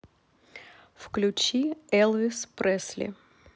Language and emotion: Russian, neutral